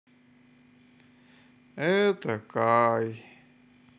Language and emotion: Russian, sad